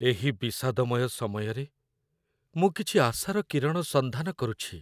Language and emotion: Odia, sad